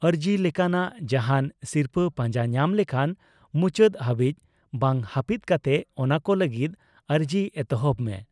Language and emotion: Santali, neutral